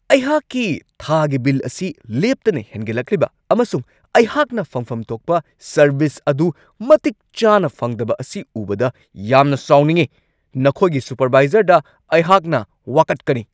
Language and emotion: Manipuri, angry